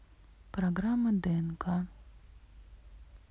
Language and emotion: Russian, neutral